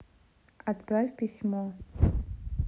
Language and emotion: Russian, neutral